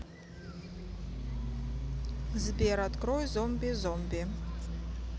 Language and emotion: Russian, neutral